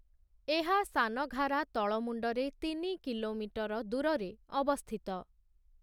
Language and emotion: Odia, neutral